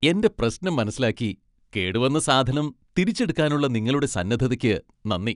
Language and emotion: Malayalam, happy